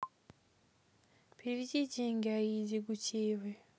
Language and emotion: Russian, neutral